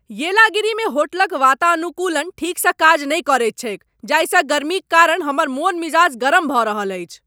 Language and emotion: Maithili, angry